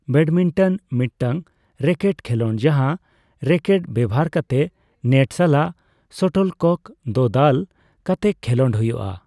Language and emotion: Santali, neutral